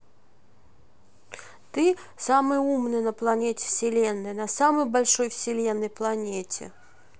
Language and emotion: Russian, neutral